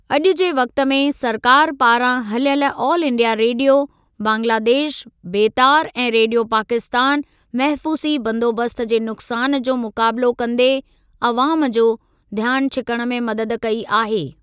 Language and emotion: Sindhi, neutral